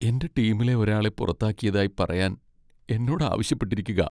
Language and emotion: Malayalam, sad